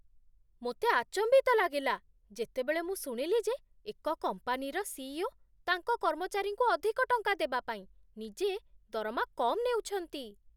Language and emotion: Odia, surprised